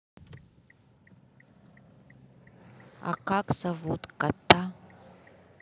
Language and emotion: Russian, neutral